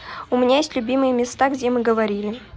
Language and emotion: Russian, neutral